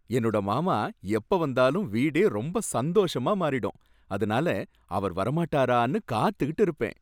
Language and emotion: Tamil, happy